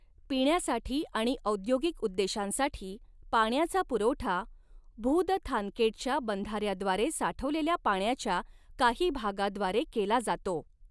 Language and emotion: Marathi, neutral